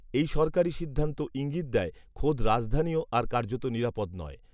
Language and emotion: Bengali, neutral